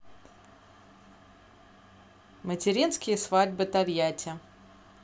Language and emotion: Russian, neutral